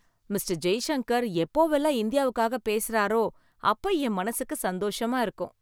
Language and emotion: Tamil, happy